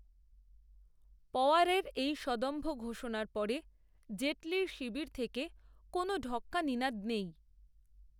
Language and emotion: Bengali, neutral